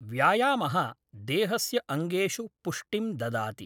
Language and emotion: Sanskrit, neutral